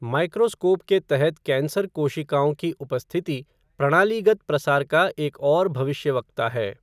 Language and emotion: Hindi, neutral